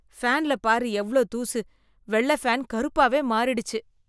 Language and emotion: Tamil, disgusted